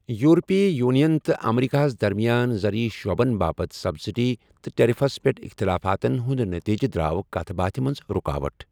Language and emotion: Kashmiri, neutral